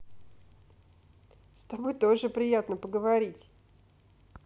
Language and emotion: Russian, neutral